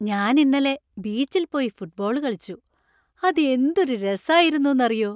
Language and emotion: Malayalam, happy